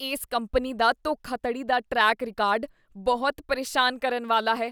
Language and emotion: Punjabi, disgusted